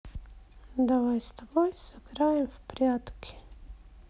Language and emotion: Russian, sad